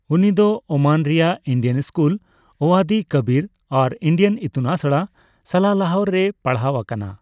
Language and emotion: Santali, neutral